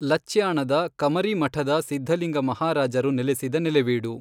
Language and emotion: Kannada, neutral